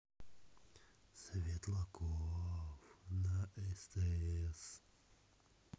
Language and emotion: Russian, neutral